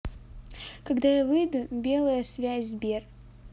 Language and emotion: Russian, neutral